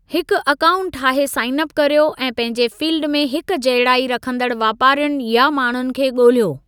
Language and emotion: Sindhi, neutral